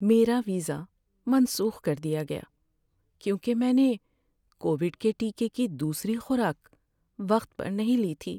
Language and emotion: Urdu, sad